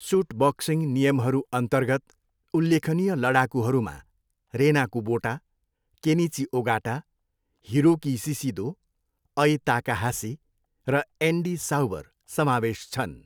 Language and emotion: Nepali, neutral